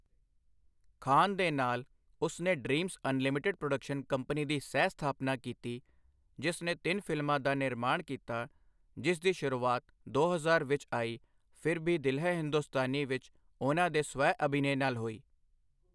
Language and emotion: Punjabi, neutral